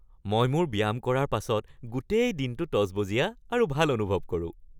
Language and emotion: Assamese, happy